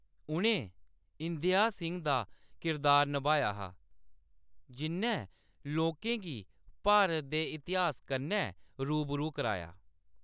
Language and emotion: Dogri, neutral